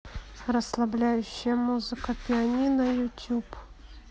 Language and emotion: Russian, neutral